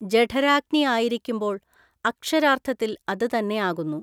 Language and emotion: Malayalam, neutral